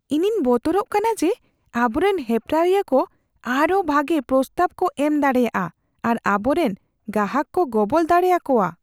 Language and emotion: Santali, fearful